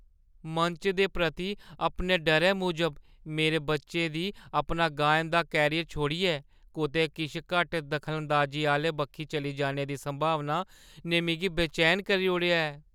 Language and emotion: Dogri, fearful